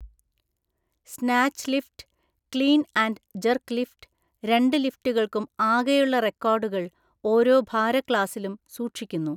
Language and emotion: Malayalam, neutral